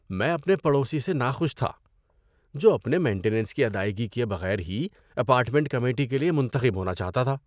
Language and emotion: Urdu, disgusted